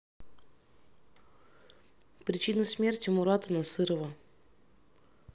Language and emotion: Russian, neutral